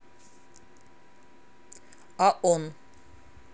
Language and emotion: Russian, neutral